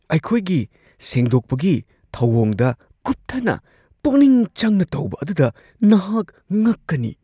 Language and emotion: Manipuri, surprised